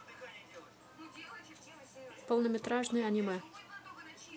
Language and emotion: Russian, neutral